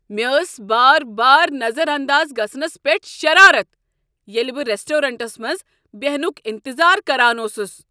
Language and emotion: Kashmiri, angry